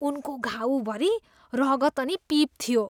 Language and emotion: Nepali, disgusted